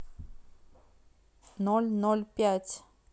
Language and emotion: Russian, neutral